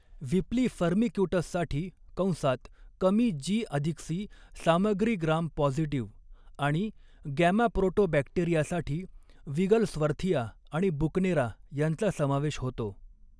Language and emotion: Marathi, neutral